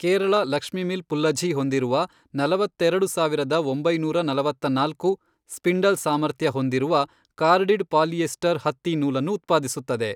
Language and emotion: Kannada, neutral